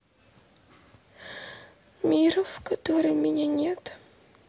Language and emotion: Russian, sad